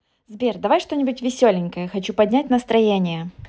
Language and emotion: Russian, positive